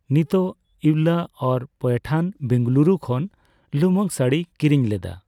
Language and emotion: Santali, neutral